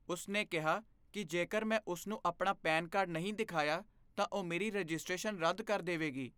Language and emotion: Punjabi, fearful